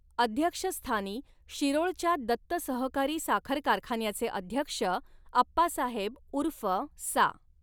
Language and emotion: Marathi, neutral